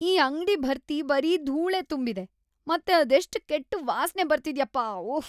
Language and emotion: Kannada, disgusted